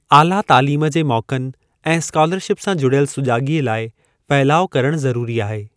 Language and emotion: Sindhi, neutral